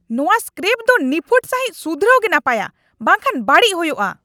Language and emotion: Santali, angry